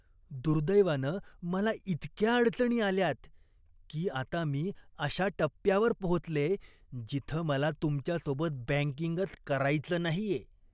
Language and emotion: Marathi, disgusted